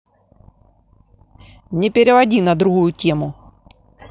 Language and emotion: Russian, angry